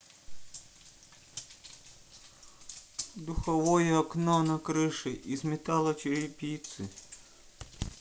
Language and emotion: Russian, sad